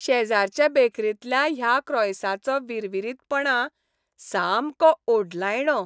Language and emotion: Goan Konkani, happy